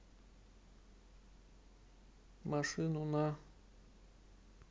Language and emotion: Russian, neutral